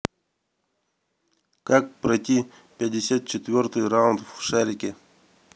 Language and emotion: Russian, neutral